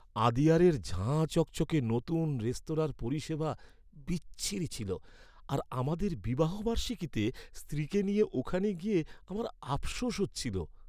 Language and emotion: Bengali, sad